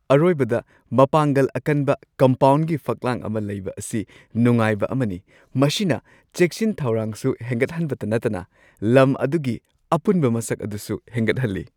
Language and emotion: Manipuri, happy